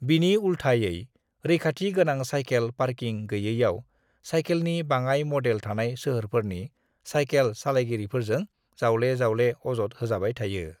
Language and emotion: Bodo, neutral